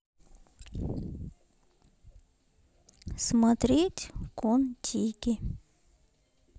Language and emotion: Russian, neutral